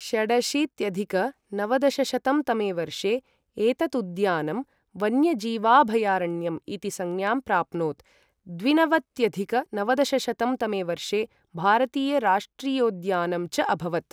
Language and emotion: Sanskrit, neutral